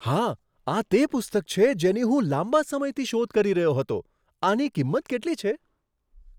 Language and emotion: Gujarati, surprised